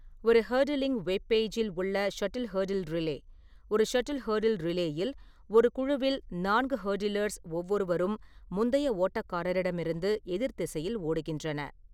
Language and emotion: Tamil, neutral